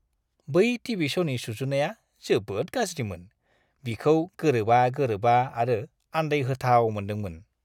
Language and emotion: Bodo, disgusted